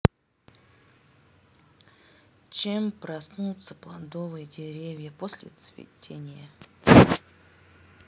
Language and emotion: Russian, neutral